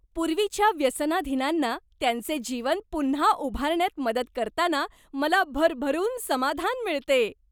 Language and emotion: Marathi, happy